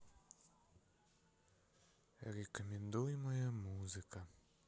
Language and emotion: Russian, sad